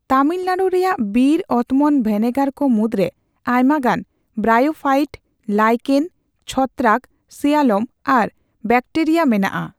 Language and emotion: Santali, neutral